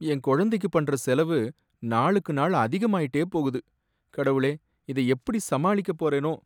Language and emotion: Tamil, sad